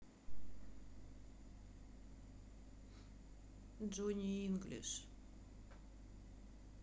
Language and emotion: Russian, sad